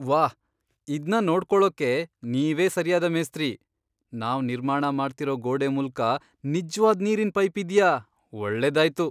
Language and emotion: Kannada, surprised